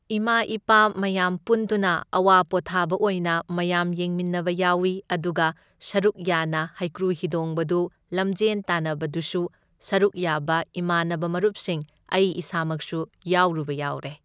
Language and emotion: Manipuri, neutral